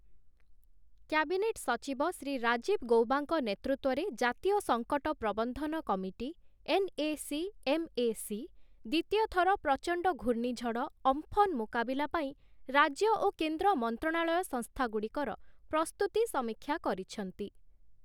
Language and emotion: Odia, neutral